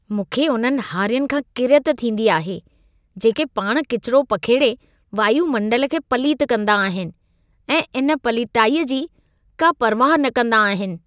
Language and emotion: Sindhi, disgusted